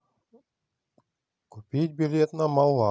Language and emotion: Russian, neutral